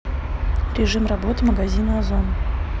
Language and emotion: Russian, neutral